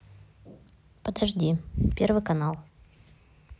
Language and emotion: Russian, neutral